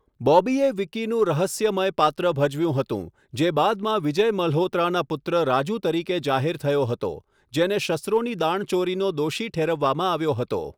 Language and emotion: Gujarati, neutral